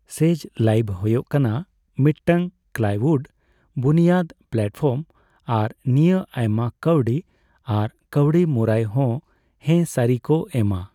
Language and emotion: Santali, neutral